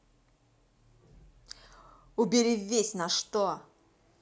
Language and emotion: Russian, angry